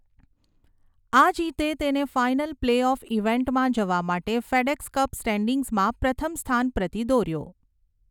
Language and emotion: Gujarati, neutral